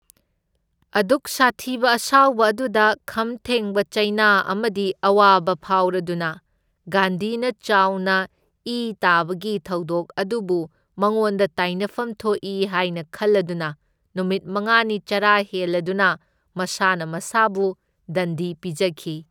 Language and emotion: Manipuri, neutral